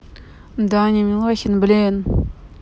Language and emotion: Russian, neutral